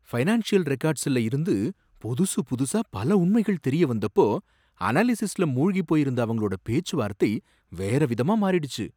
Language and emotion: Tamil, surprised